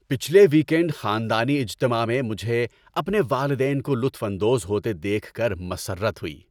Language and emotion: Urdu, happy